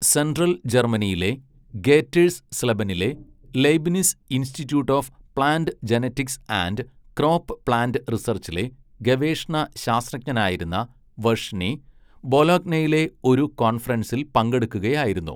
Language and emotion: Malayalam, neutral